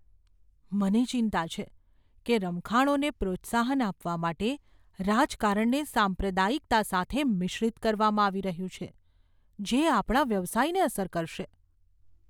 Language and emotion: Gujarati, fearful